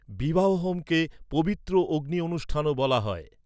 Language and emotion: Bengali, neutral